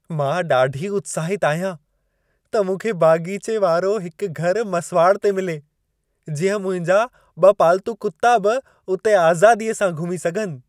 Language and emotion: Sindhi, happy